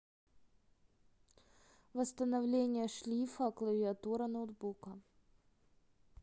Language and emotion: Russian, neutral